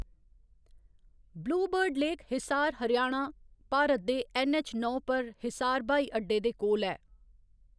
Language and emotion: Dogri, neutral